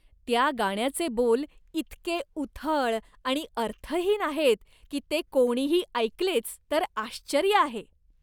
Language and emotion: Marathi, disgusted